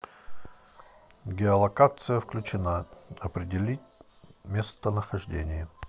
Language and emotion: Russian, neutral